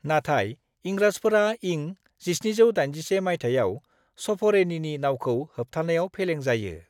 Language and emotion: Bodo, neutral